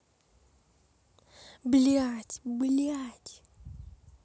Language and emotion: Russian, neutral